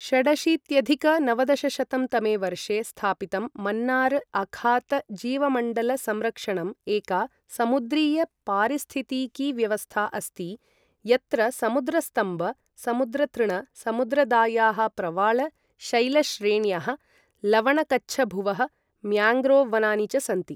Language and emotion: Sanskrit, neutral